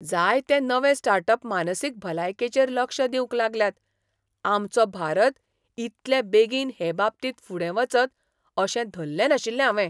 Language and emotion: Goan Konkani, surprised